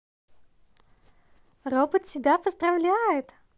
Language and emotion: Russian, positive